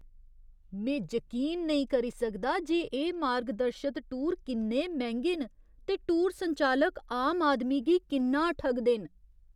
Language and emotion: Dogri, disgusted